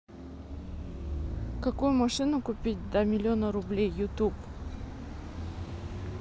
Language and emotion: Russian, neutral